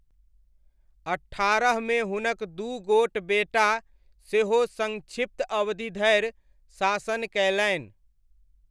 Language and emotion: Maithili, neutral